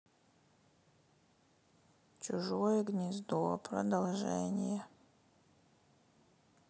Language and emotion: Russian, sad